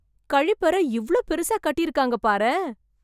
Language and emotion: Tamil, surprised